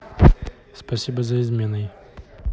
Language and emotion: Russian, neutral